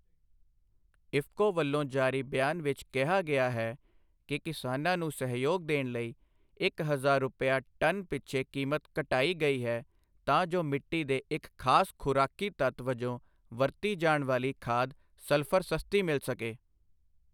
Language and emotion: Punjabi, neutral